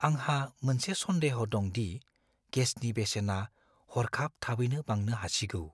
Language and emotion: Bodo, fearful